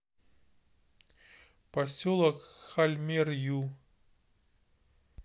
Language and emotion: Russian, neutral